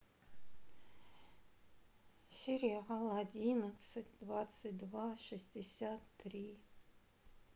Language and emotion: Russian, sad